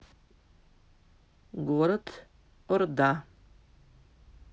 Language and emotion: Russian, neutral